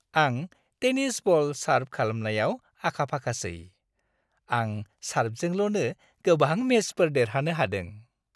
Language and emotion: Bodo, happy